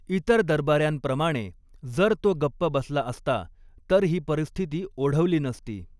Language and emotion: Marathi, neutral